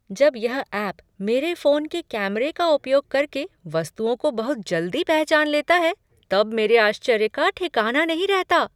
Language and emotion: Hindi, surprised